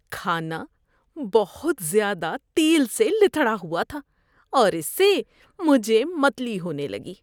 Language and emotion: Urdu, disgusted